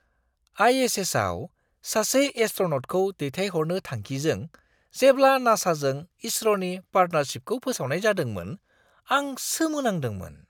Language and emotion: Bodo, surprised